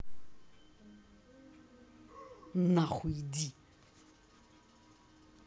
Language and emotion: Russian, angry